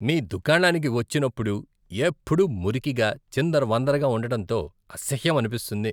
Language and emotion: Telugu, disgusted